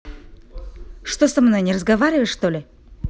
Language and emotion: Russian, angry